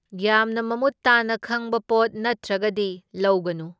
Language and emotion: Manipuri, neutral